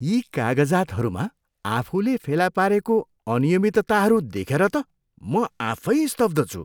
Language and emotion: Nepali, disgusted